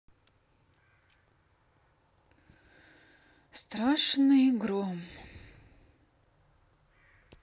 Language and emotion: Russian, sad